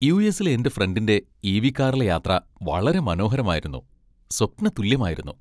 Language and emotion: Malayalam, happy